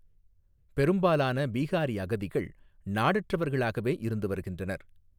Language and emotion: Tamil, neutral